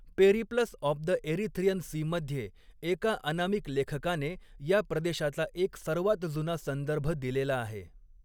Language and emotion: Marathi, neutral